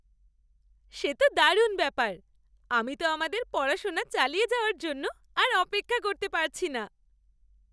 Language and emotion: Bengali, happy